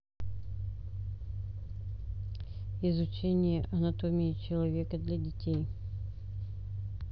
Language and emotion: Russian, neutral